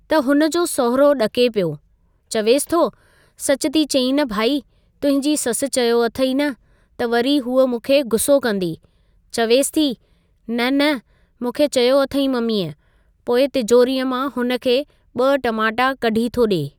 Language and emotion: Sindhi, neutral